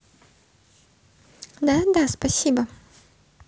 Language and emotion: Russian, positive